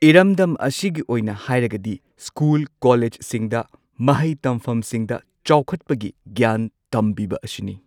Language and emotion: Manipuri, neutral